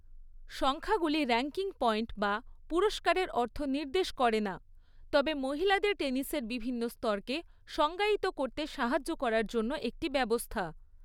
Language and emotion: Bengali, neutral